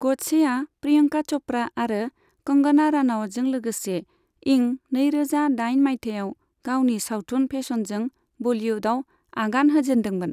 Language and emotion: Bodo, neutral